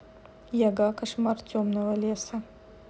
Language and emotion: Russian, neutral